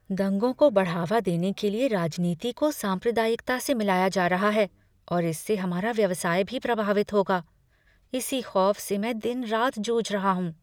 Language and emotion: Hindi, fearful